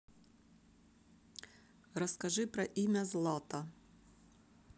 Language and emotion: Russian, neutral